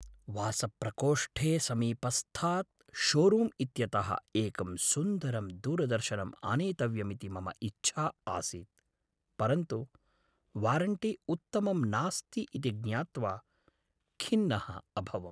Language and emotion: Sanskrit, sad